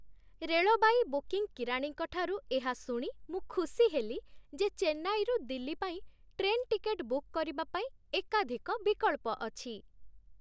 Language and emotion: Odia, happy